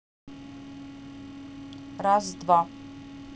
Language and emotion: Russian, neutral